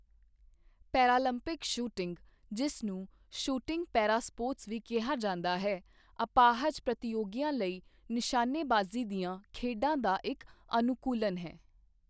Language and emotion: Punjabi, neutral